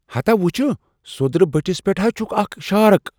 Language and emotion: Kashmiri, surprised